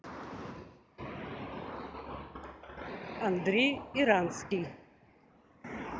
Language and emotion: Russian, neutral